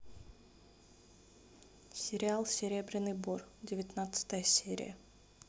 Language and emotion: Russian, neutral